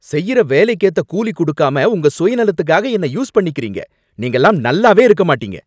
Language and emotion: Tamil, angry